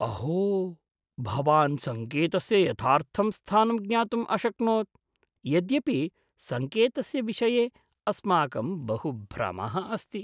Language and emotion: Sanskrit, surprised